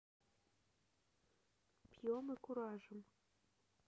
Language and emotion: Russian, neutral